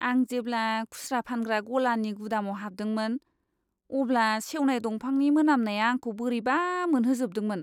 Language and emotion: Bodo, disgusted